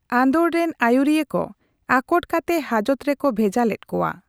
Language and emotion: Santali, neutral